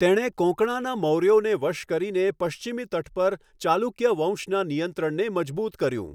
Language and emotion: Gujarati, neutral